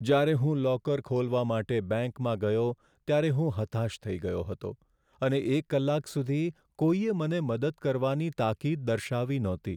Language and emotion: Gujarati, sad